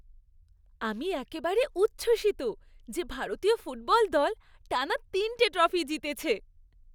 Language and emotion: Bengali, happy